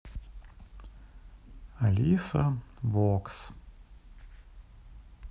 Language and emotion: Russian, neutral